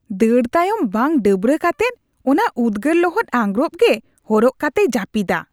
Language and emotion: Santali, disgusted